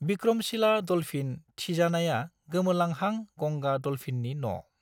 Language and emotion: Bodo, neutral